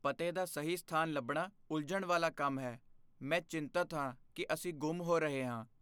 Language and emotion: Punjabi, fearful